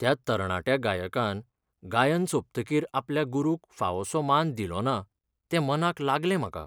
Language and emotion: Goan Konkani, sad